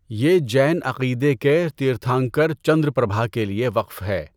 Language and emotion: Urdu, neutral